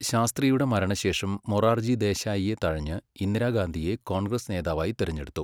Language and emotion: Malayalam, neutral